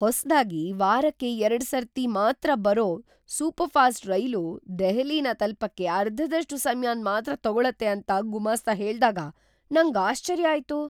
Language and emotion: Kannada, surprised